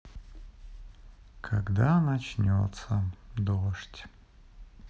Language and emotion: Russian, sad